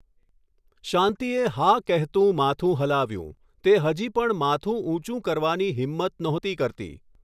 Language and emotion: Gujarati, neutral